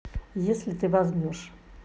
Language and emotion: Russian, neutral